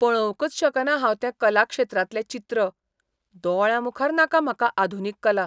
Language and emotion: Goan Konkani, disgusted